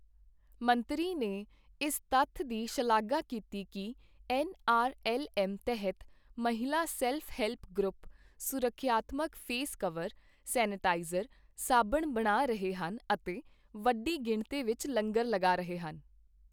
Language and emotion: Punjabi, neutral